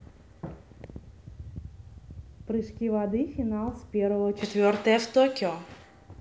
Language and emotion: Russian, neutral